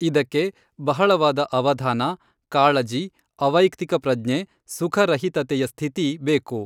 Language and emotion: Kannada, neutral